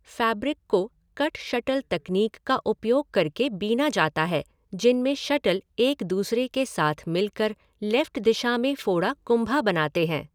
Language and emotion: Hindi, neutral